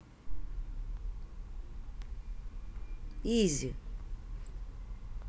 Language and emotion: Russian, neutral